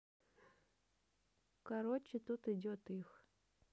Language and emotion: Russian, neutral